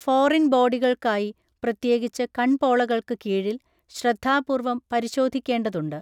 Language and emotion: Malayalam, neutral